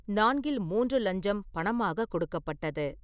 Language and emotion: Tamil, neutral